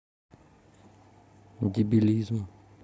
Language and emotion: Russian, sad